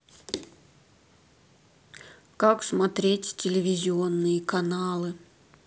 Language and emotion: Russian, neutral